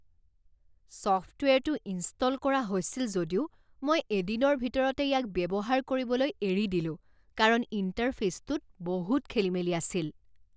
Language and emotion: Assamese, disgusted